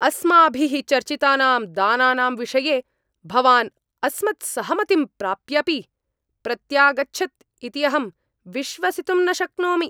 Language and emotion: Sanskrit, angry